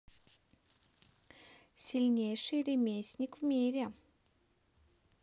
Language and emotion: Russian, neutral